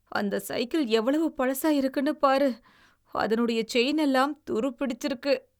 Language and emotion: Tamil, disgusted